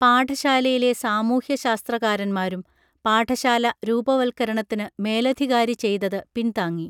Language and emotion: Malayalam, neutral